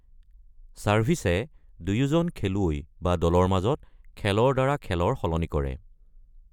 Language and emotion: Assamese, neutral